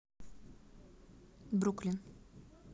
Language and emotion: Russian, neutral